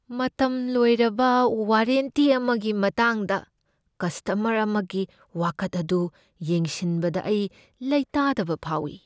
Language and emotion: Manipuri, fearful